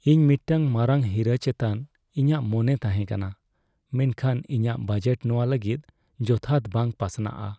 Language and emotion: Santali, sad